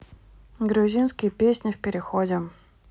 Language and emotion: Russian, neutral